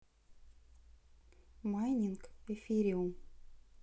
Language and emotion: Russian, neutral